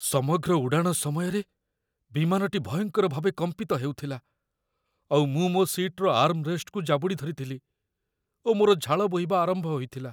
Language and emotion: Odia, fearful